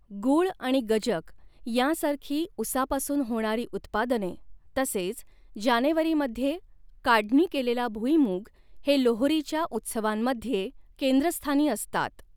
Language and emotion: Marathi, neutral